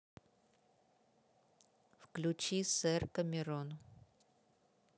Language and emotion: Russian, neutral